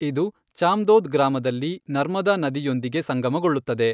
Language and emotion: Kannada, neutral